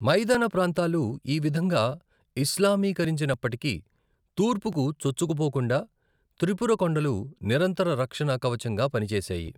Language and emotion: Telugu, neutral